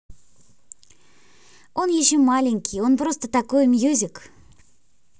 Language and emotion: Russian, neutral